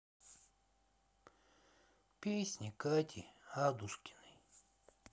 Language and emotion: Russian, sad